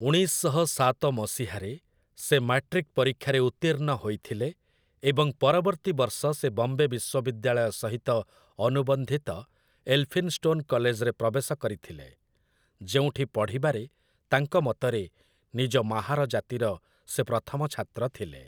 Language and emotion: Odia, neutral